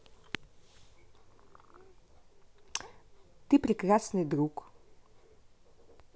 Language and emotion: Russian, positive